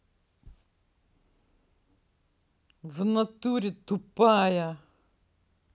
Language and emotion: Russian, angry